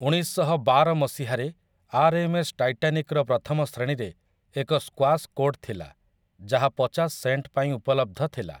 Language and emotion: Odia, neutral